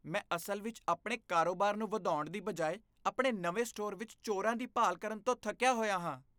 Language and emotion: Punjabi, disgusted